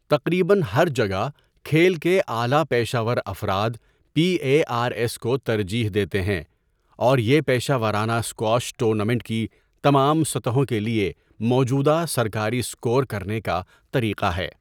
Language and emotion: Urdu, neutral